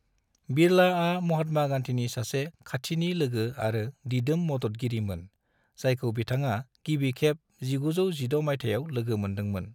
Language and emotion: Bodo, neutral